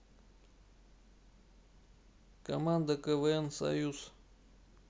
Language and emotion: Russian, neutral